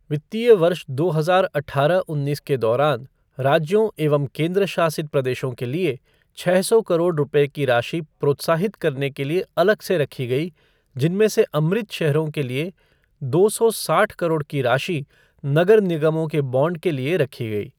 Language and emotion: Hindi, neutral